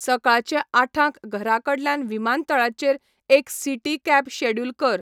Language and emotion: Goan Konkani, neutral